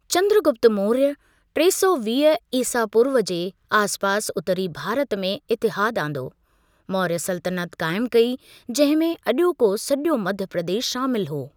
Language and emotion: Sindhi, neutral